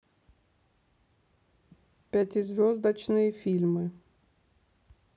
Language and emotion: Russian, neutral